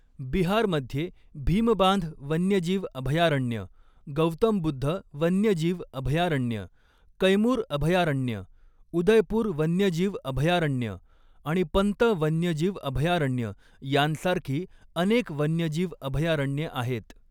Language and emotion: Marathi, neutral